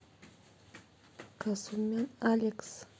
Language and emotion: Russian, neutral